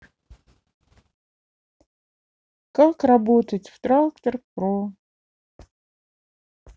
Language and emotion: Russian, sad